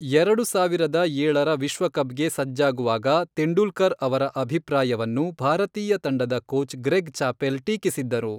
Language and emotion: Kannada, neutral